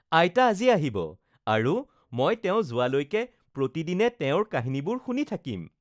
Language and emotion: Assamese, happy